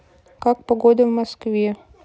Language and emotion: Russian, neutral